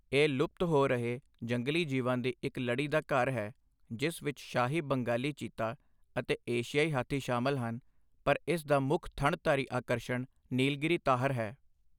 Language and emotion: Punjabi, neutral